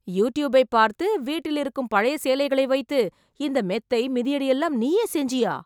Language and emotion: Tamil, surprised